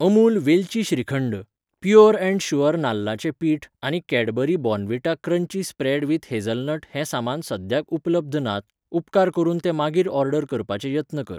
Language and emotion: Goan Konkani, neutral